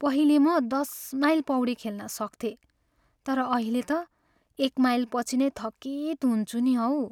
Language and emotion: Nepali, sad